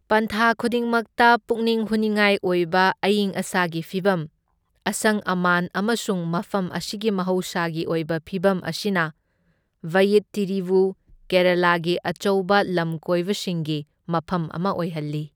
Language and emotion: Manipuri, neutral